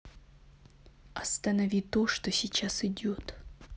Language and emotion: Russian, angry